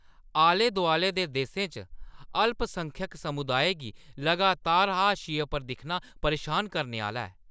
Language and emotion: Dogri, angry